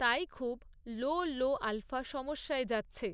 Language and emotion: Bengali, neutral